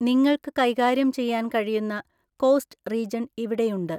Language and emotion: Malayalam, neutral